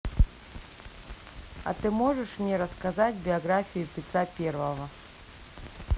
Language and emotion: Russian, neutral